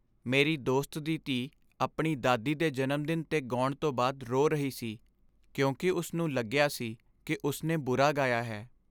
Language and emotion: Punjabi, sad